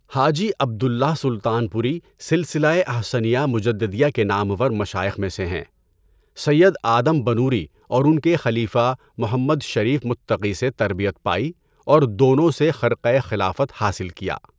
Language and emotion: Urdu, neutral